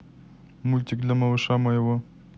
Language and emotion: Russian, neutral